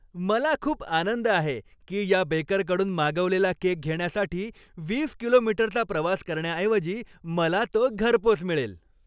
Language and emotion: Marathi, happy